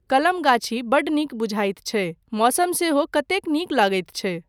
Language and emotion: Maithili, neutral